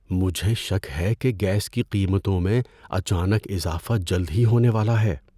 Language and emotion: Urdu, fearful